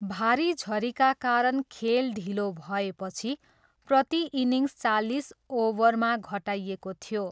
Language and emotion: Nepali, neutral